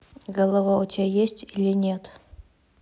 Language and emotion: Russian, neutral